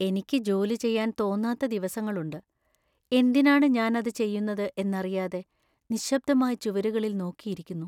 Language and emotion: Malayalam, sad